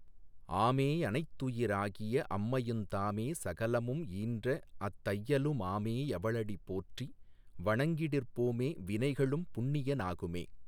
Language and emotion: Tamil, neutral